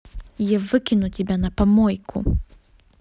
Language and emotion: Russian, angry